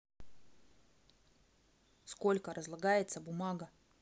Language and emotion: Russian, angry